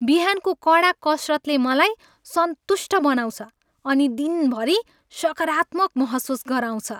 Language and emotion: Nepali, happy